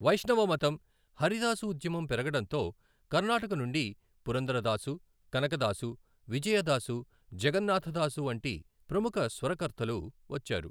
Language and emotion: Telugu, neutral